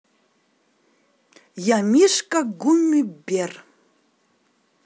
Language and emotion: Russian, positive